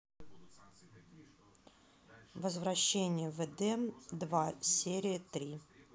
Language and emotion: Russian, neutral